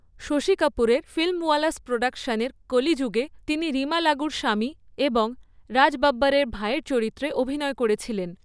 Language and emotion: Bengali, neutral